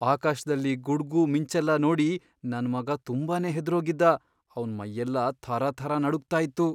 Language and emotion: Kannada, fearful